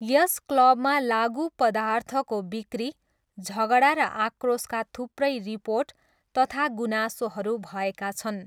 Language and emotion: Nepali, neutral